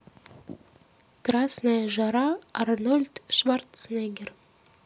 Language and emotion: Russian, neutral